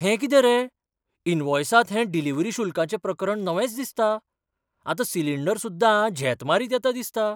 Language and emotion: Goan Konkani, surprised